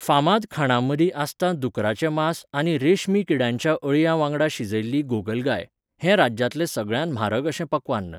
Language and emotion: Goan Konkani, neutral